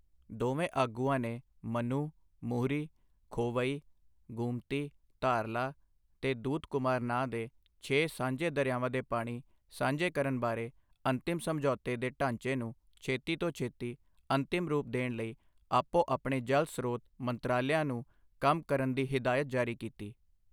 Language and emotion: Punjabi, neutral